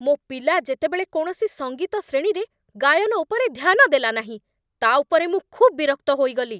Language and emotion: Odia, angry